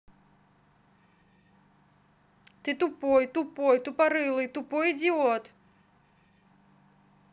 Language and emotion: Russian, neutral